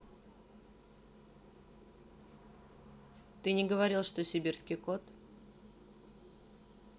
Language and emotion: Russian, neutral